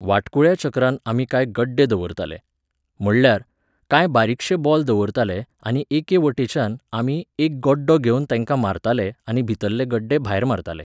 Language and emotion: Goan Konkani, neutral